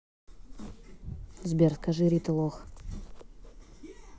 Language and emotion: Russian, neutral